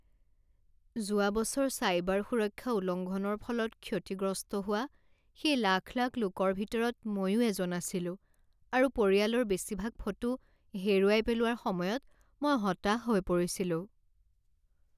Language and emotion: Assamese, sad